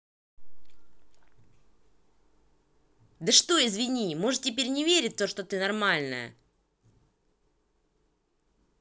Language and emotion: Russian, angry